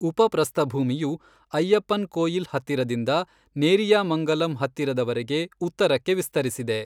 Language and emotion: Kannada, neutral